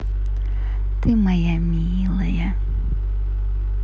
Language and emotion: Russian, positive